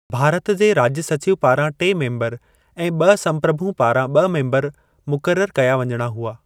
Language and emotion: Sindhi, neutral